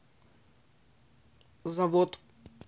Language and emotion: Russian, neutral